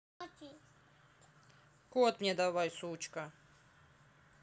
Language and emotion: Russian, angry